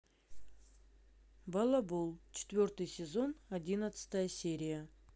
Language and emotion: Russian, neutral